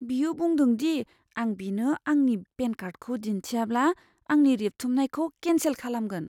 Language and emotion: Bodo, fearful